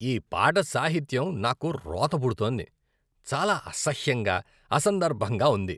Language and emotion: Telugu, disgusted